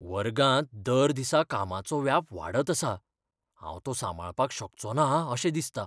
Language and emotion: Goan Konkani, fearful